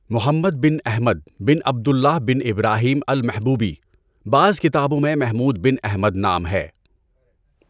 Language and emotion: Urdu, neutral